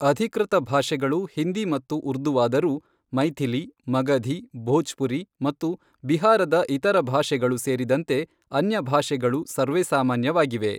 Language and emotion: Kannada, neutral